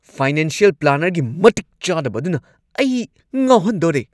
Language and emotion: Manipuri, angry